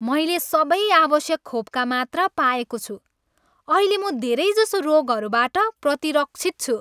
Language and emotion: Nepali, happy